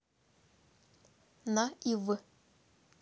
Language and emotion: Russian, neutral